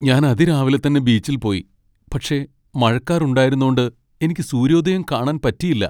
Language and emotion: Malayalam, sad